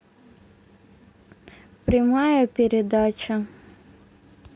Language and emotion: Russian, neutral